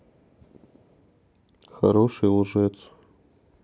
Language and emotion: Russian, neutral